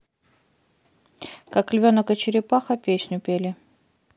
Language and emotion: Russian, neutral